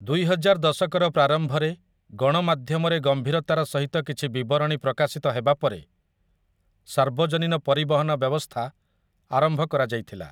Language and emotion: Odia, neutral